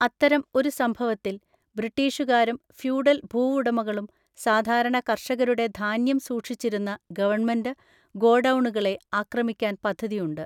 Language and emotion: Malayalam, neutral